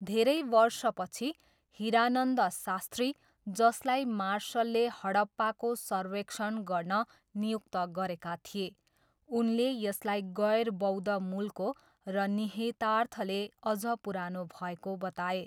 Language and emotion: Nepali, neutral